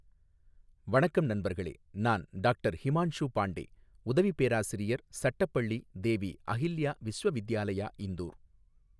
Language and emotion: Tamil, neutral